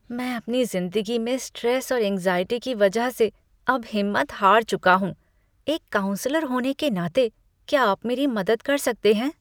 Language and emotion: Hindi, disgusted